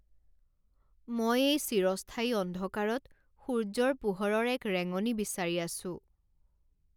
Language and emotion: Assamese, sad